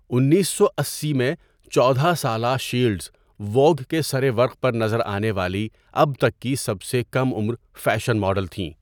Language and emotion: Urdu, neutral